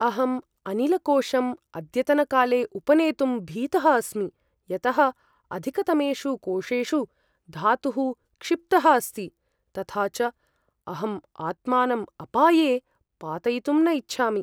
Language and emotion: Sanskrit, fearful